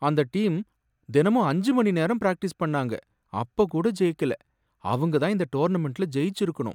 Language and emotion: Tamil, sad